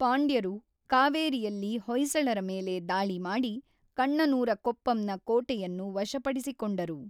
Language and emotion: Kannada, neutral